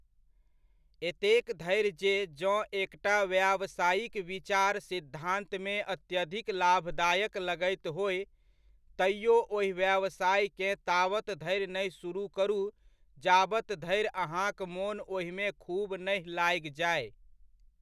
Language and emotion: Maithili, neutral